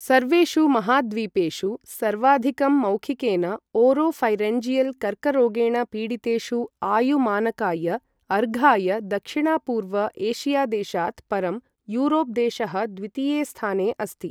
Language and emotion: Sanskrit, neutral